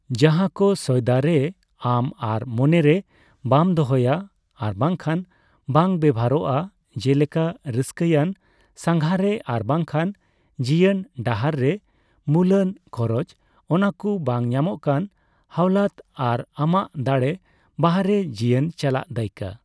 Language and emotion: Santali, neutral